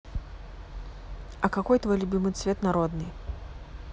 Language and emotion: Russian, neutral